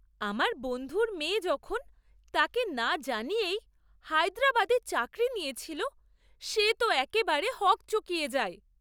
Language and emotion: Bengali, surprised